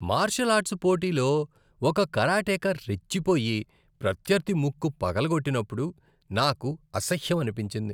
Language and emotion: Telugu, disgusted